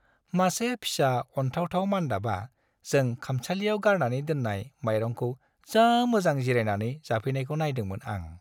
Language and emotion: Bodo, happy